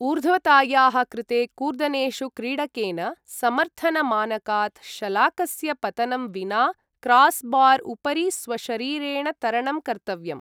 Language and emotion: Sanskrit, neutral